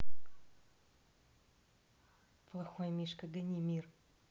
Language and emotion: Russian, neutral